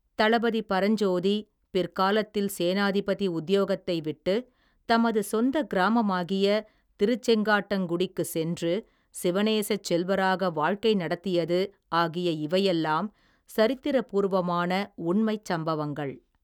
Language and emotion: Tamil, neutral